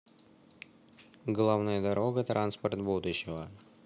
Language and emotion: Russian, neutral